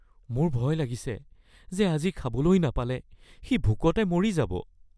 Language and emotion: Assamese, fearful